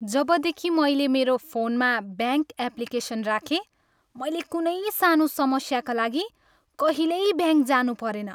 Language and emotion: Nepali, happy